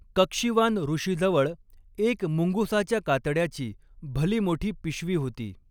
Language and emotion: Marathi, neutral